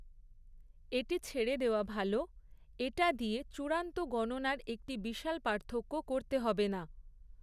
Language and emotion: Bengali, neutral